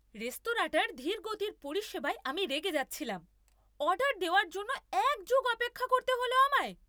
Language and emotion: Bengali, angry